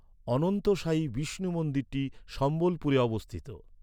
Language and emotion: Bengali, neutral